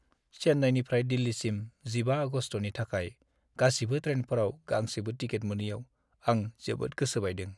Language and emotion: Bodo, sad